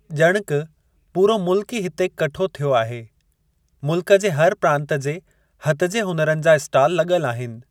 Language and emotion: Sindhi, neutral